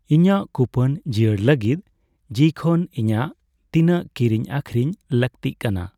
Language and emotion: Santali, neutral